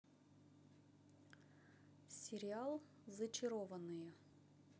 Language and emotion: Russian, neutral